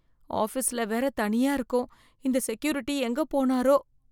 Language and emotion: Tamil, fearful